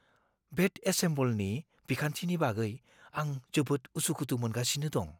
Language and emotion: Bodo, fearful